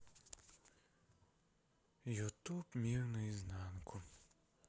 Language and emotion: Russian, sad